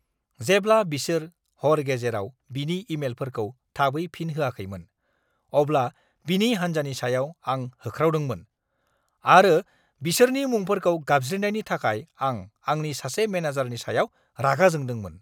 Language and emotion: Bodo, angry